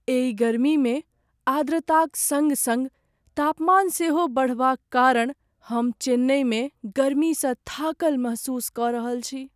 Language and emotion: Maithili, sad